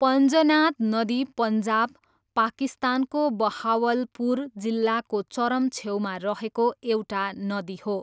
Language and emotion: Nepali, neutral